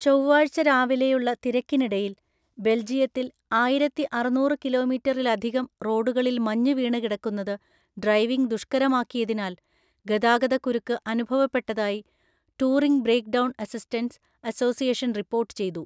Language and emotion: Malayalam, neutral